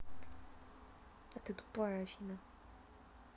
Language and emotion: Russian, neutral